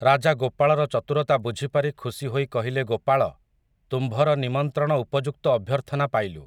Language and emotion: Odia, neutral